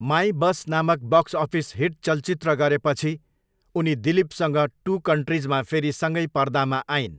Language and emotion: Nepali, neutral